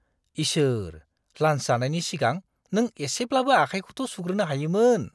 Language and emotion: Bodo, disgusted